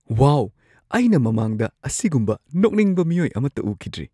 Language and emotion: Manipuri, surprised